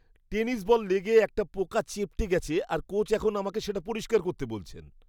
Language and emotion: Bengali, disgusted